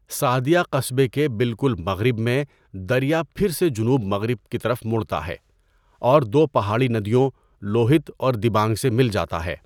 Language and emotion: Urdu, neutral